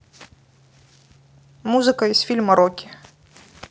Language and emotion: Russian, neutral